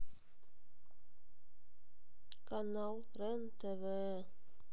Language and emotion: Russian, sad